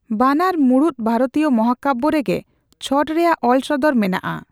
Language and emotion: Santali, neutral